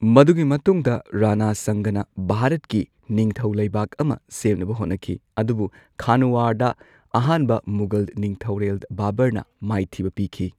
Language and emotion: Manipuri, neutral